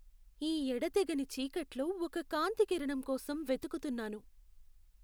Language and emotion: Telugu, sad